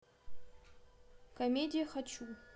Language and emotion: Russian, neutral